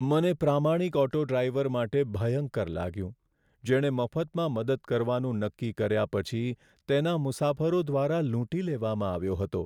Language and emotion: Gujarati, sad